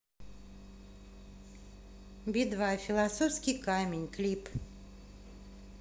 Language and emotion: Russian, neutral